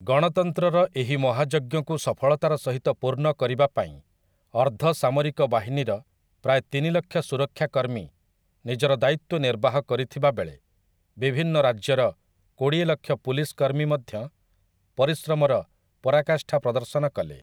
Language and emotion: Odia, neutral